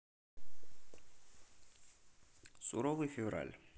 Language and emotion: Russian, neutral